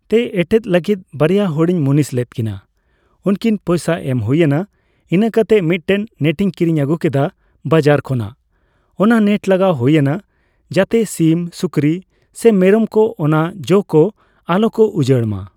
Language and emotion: Santali, neutral